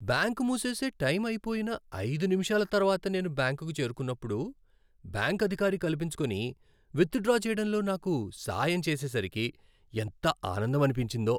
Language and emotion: Telugu, happy